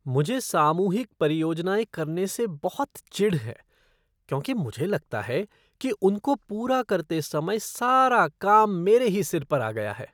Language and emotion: Hindi, disgusted